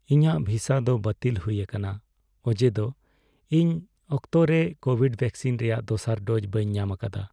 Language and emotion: Santali, sad